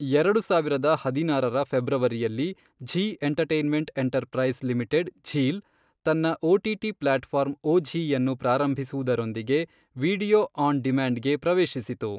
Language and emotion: Kannada, neutral